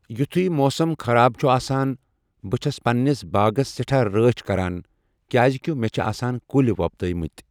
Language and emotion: Kashmiri, neutral